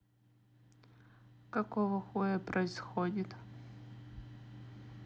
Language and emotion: Russian, neutral